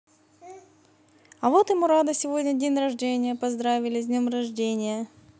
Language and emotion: Russian, positive